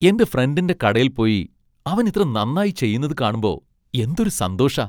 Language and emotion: Malayalam, happy